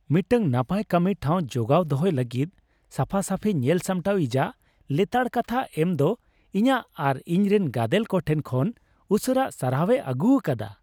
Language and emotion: Santali, happy